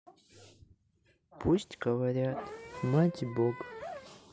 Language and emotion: Russian, sad